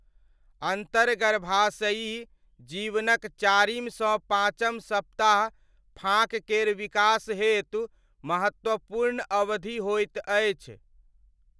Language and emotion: Maithili, neutral